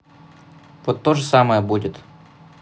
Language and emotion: Russian, neutral